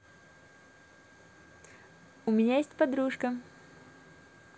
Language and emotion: Russian, positive